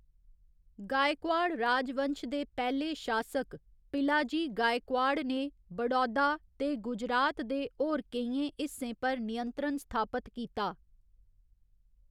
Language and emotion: Dogri, neutral